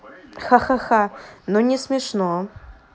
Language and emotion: Russian, neutral